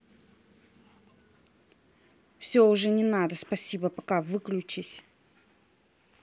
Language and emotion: Russian, angry